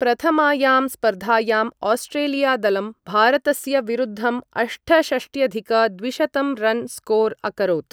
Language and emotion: Sanskrit, neutral